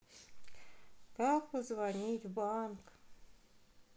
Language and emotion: Russian, sad